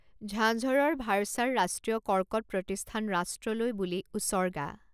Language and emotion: Assamese, neutral